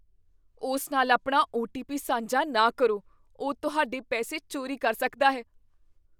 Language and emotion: Punjabi, fearful